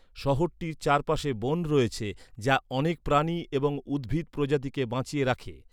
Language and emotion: Bengali, neutral